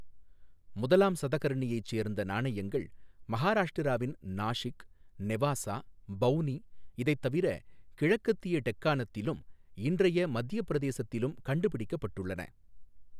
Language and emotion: Tamil, neutral